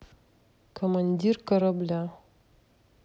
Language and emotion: Russian, neutral